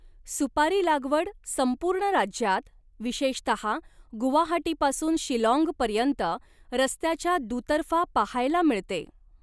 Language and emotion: Marathi, neutral